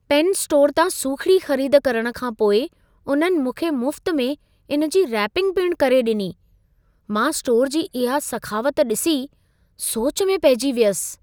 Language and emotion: Sindhi, surprised